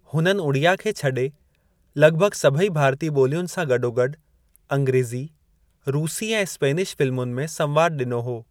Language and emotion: Sindhi, neutral